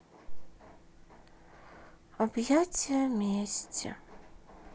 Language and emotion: Russian, sad